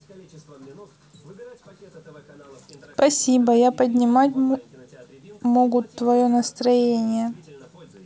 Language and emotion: Russian, neutral